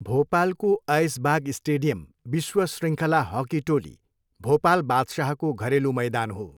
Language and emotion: Nepali, neutral